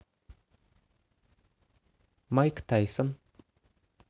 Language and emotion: Russian, neutral